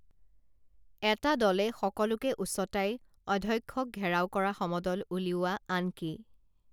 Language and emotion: Assamese, neutral